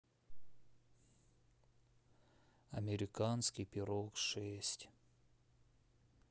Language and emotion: Russian, neutral